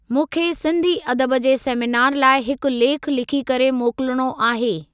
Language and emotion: Sindhi, neutral